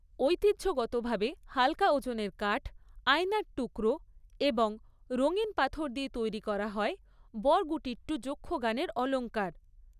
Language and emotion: Bengali, neutral